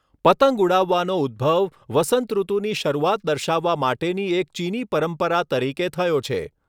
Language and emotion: Gujarati, neutral